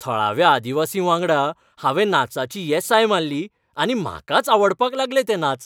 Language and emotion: Goan Konkani, happy